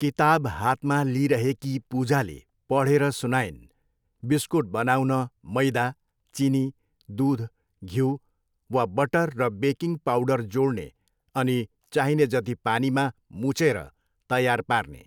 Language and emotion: Nepali, neutral